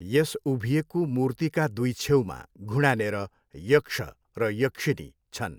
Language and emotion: Nepali, neutral